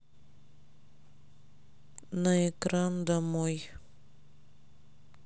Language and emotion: Russian, sad